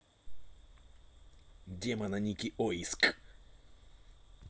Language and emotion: Russian, neutral